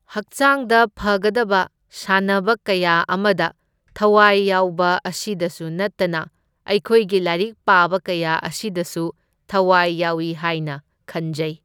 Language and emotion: Manipuri, neutral